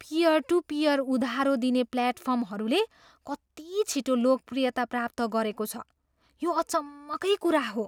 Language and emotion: Nepali, surprised